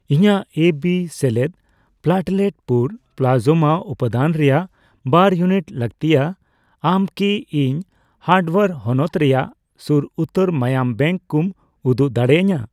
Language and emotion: Santali, neutral